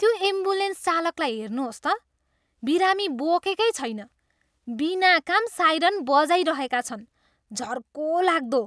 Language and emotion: Nepali, disgusted